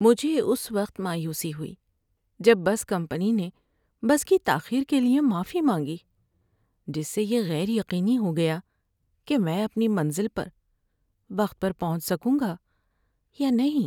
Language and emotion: Urdu, sad